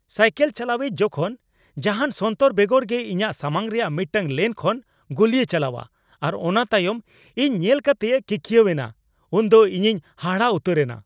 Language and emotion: Santali, angry